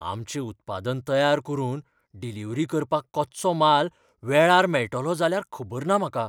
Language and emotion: Goan Konkani, fearful